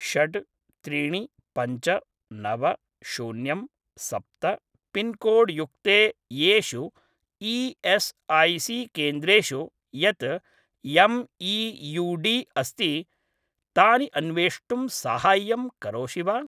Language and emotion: Sanskrit, neutral